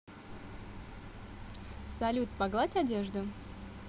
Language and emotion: Russian, positive